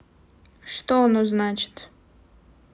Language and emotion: Russian, neutral